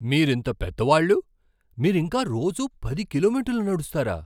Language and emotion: Telugu, surprised